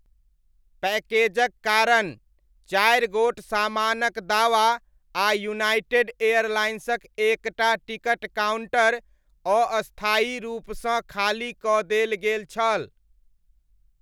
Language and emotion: Maithili, neutral